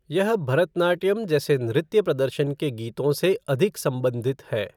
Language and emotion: Hindi, neutral